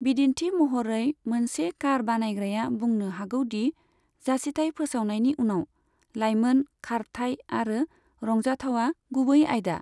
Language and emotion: Bodo, neutral